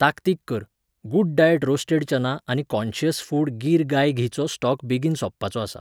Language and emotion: Goan Konkani, neutral